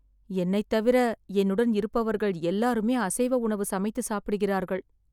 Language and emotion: Tamil, sad